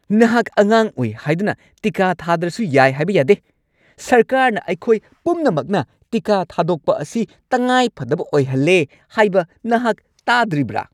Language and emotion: Manipuri, angry